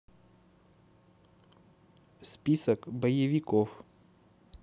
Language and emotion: Russian, neutral